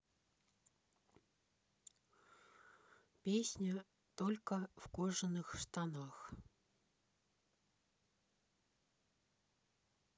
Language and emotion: Russian, neutral